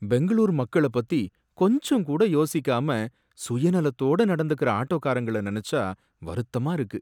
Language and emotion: Tamil, sad